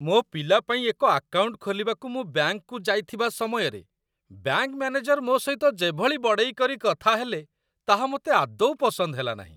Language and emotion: Odia, disgusted